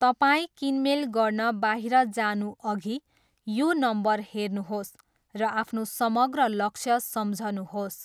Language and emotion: Nepali, neutral